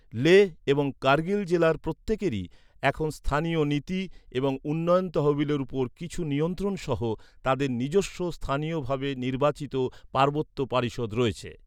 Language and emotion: Bengali, neutral